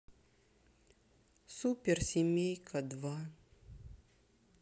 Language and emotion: Russian, sad